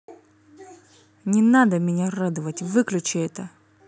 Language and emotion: Russian, angry